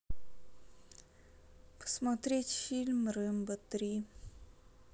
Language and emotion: Russian, sad